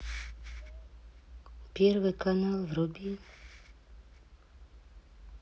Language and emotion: Russian, sad